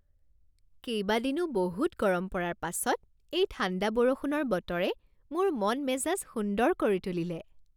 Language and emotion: Assamese, happy